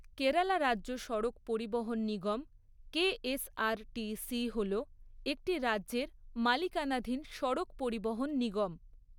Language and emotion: Bengali, neutral